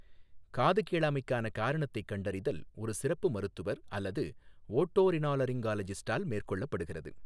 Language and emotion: Tamil, neutral